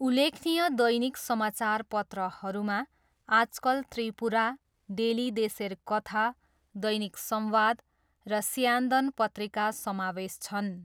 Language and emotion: Nepali, neutral